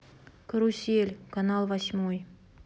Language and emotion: Russian, neutral